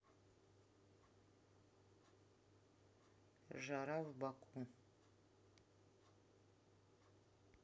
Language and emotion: Russian, neutral